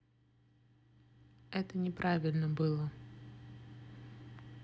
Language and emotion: Russian, neutral